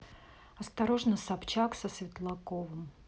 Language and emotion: Russian, neutral